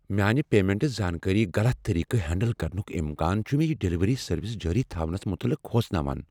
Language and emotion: Kashmiri, fearful